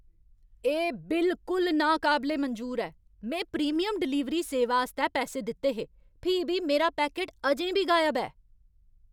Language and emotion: Dogri, angry